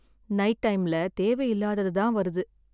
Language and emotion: Tamil, sad